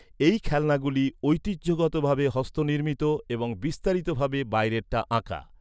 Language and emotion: Bengali, neutral